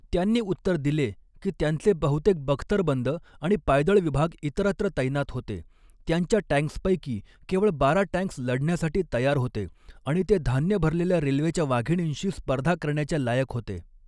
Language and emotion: Marathi, neutral